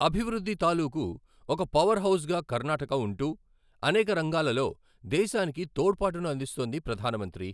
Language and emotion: Telugu, neutral